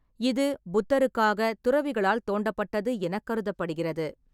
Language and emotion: Tamil, neutral